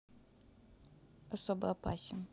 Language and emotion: Russian, neutral